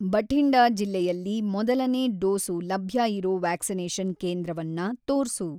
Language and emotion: Kannada, neutral